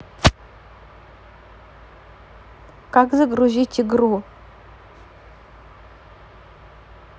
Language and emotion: Russian, neutral